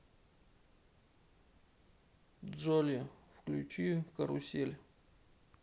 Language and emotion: Russian, neutral